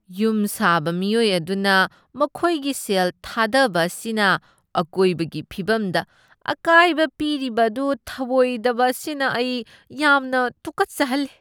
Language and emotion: Manipuri, disgusted